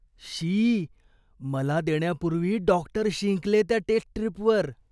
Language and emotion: Marathi, disgusted